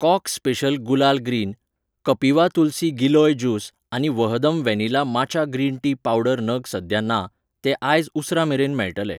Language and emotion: Goan Konkani, neutral